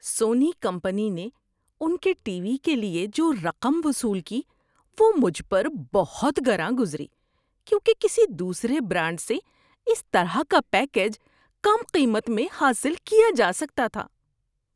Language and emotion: Urdu, disgusted